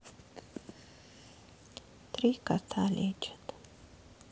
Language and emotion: Russian, sad